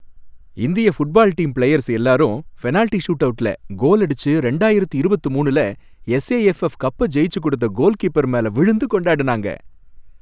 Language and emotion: Tamil, happy